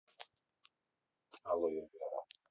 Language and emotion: Russian, neutral